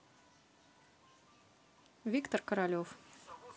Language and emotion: Russian, neutral